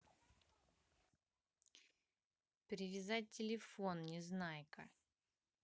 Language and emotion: Russian, neutral